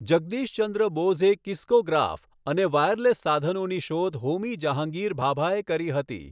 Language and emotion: Gujarati, neutral